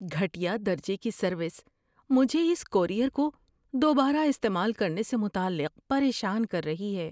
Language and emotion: Urdu, fearful